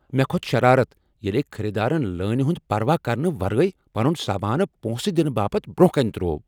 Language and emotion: Kashmiri, angry